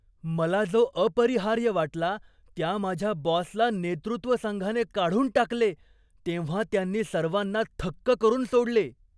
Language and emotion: Marathi, surprised